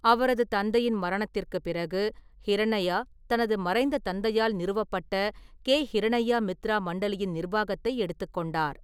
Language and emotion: Tamil, neutral